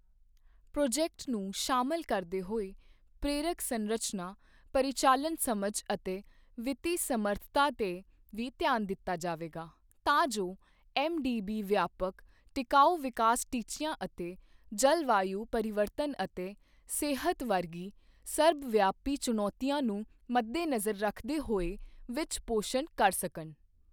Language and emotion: Punjabi, neutral